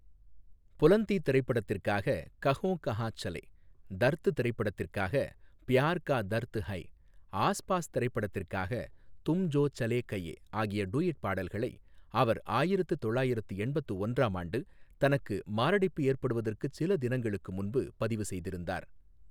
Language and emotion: Tamil, neutral